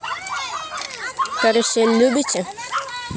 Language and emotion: Russian, neutral